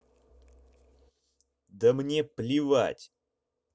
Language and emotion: Russian, angry